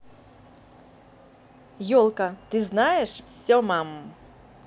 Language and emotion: Russian, positive